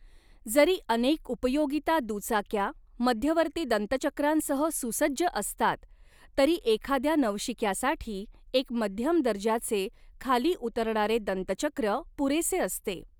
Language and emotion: Marathi, neutral